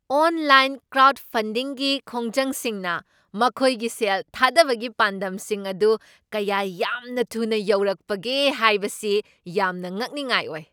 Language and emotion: Manipuri, surprised